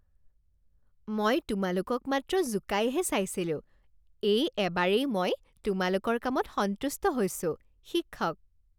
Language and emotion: Assamese, happy